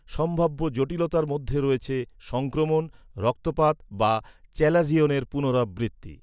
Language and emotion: Bengali, neutral